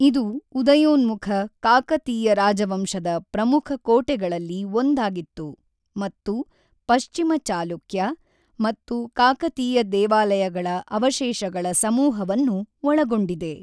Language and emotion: Kannada, neutral